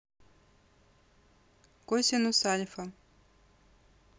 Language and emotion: Russian, neutral